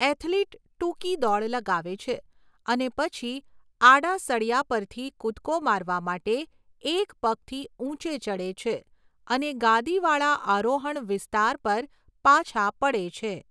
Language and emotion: Gujarati, neutral